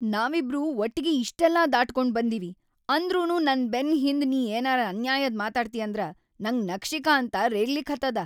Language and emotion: Kannada, angry